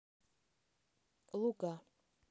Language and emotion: Russian, neutral